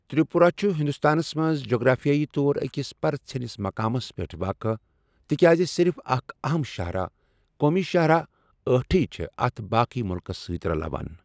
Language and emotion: Kashmiri, neutral